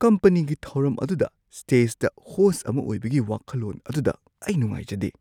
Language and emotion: Manipuri, fearful